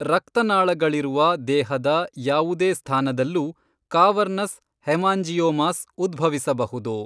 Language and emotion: Kannada, neutral